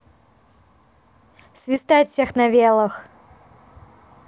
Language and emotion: Russian, positive